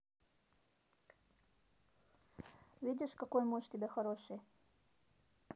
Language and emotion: Russian, neutral